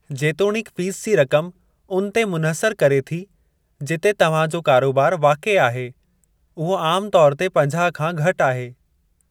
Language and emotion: Sindhi, neutral